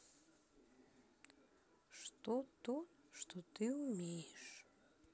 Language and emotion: Russian, neutral